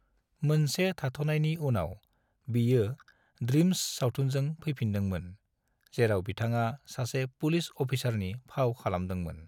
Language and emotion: Bodo, neutral